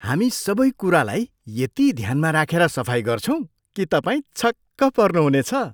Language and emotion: Nepali, surprised